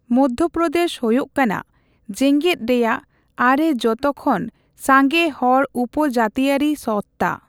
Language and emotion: Santali, neutral